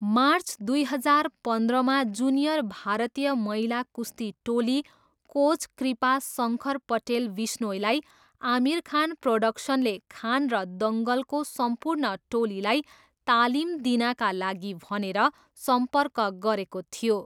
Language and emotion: Nepali, neutral